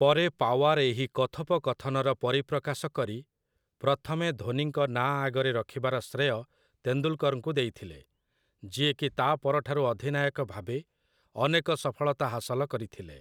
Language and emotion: Odia, neutral